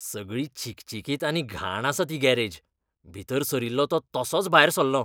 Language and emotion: Goan Konkani, disgusted